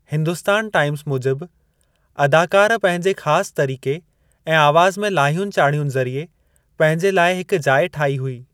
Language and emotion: Sindhi, neutral